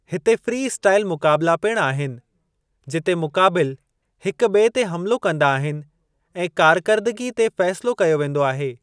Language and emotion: Sindhi, neutral